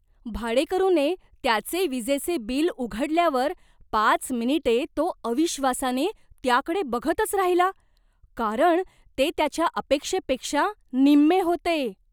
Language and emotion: Marathi, surprised